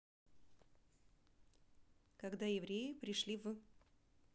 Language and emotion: Russian, neutral